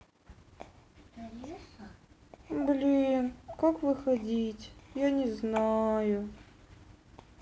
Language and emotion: Russian, sad